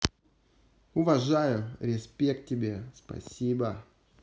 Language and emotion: Russian, positive